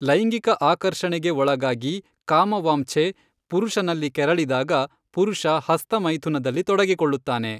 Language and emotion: Kannada, neutral